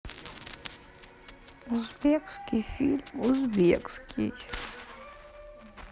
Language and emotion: Russian, sad